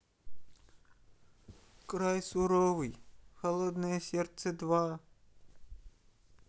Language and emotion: Russian, sad